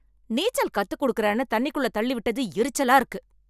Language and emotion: Tamil, angry